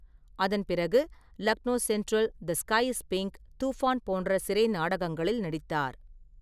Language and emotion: Tamil, neutral